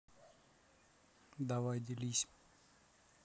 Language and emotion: Russian, neutral